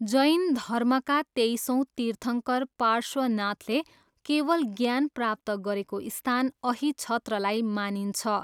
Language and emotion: Nepali, neutral